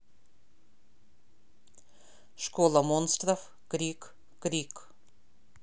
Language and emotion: Russian, neutral